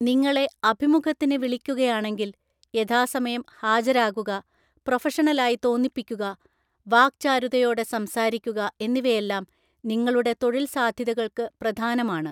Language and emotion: Malayalam, neutral